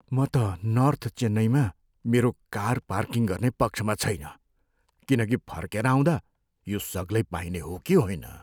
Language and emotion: Nepali, fearful